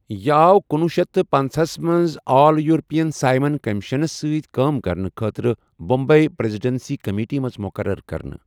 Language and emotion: Kashmiri, neutral